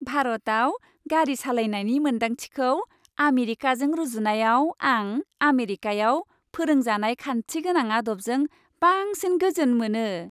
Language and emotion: Bodo, happy